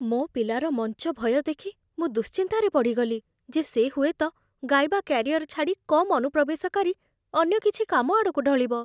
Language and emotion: Odia, fearful